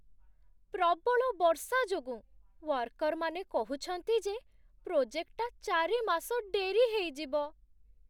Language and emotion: Odia, sad